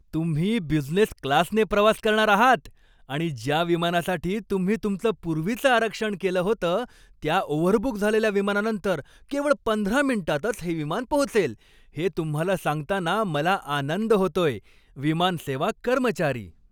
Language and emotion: Marathi, happy